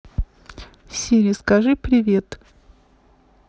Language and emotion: Russian, neutral